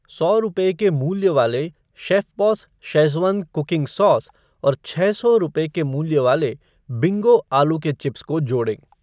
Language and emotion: Hindi, neutral